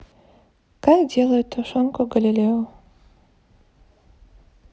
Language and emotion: Russian, neutral